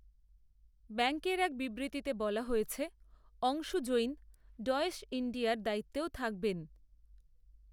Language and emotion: Bengali, neutral